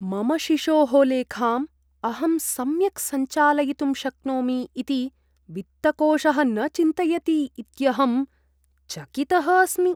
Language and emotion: Sanskrit, disgusted